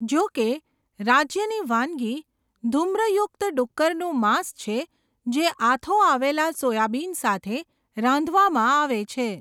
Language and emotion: Gujarati, neutral